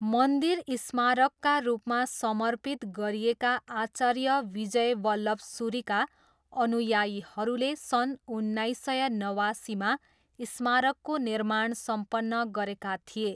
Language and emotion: Nepali, neutral